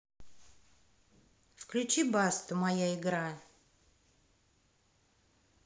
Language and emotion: Russian, neutral